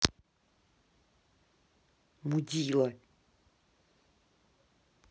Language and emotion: Russian, angry